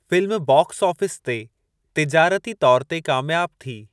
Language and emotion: Sindhi, neutral